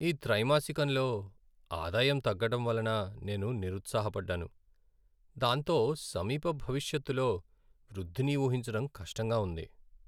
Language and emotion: Telugu, sad